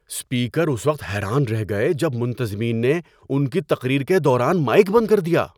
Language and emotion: Urdu, surprised